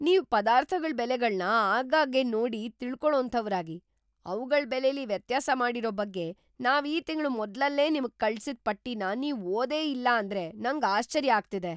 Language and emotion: Kannada, surprised